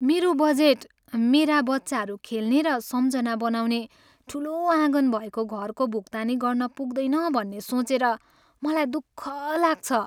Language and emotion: Nepali, sad